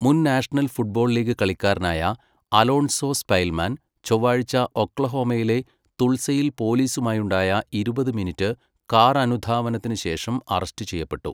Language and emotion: Malayalam, neutral